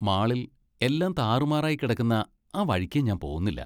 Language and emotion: Malayalam, disgusted